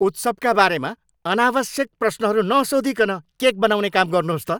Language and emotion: Nepali, angry